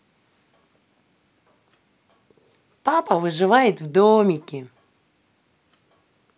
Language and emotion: Russian, positive